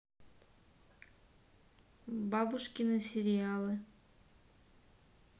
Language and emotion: Russian, neutral